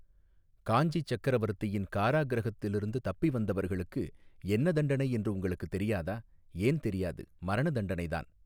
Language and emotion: Tamil, neutral